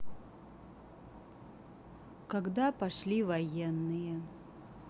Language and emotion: Russian, neutral